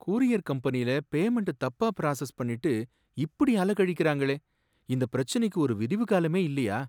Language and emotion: Tamil, sad